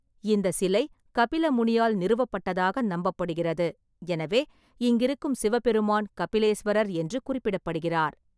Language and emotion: Tamil, neutral